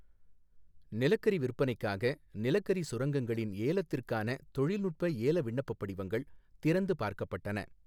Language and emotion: Tamil, neutral